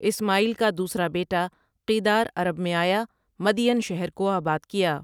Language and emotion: Urdu, neutral